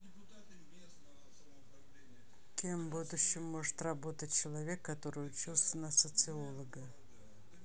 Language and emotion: Russian, neutral